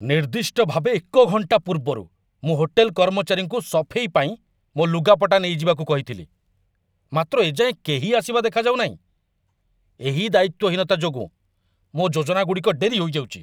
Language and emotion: Odia, angry